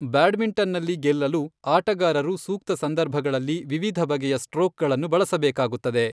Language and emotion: Kannada, neutral